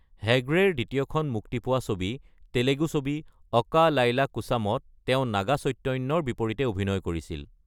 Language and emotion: Assamese, neutral